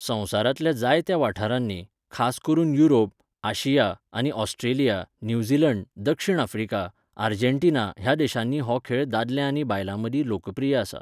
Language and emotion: Goan Konkani, neutral